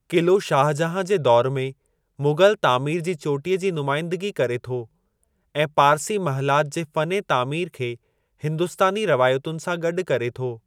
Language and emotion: Sindhi, neutral